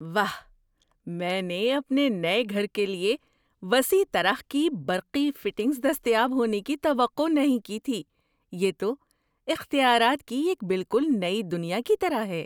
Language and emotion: Urdu, surprised